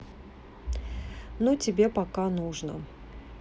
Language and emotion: Russian, neutral